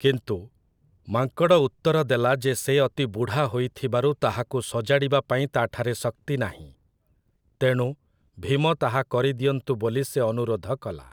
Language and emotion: Odia, neutral